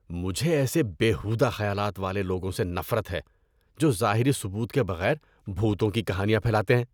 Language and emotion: Urdu, disgusted